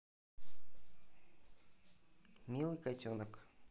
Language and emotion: Russian, neutral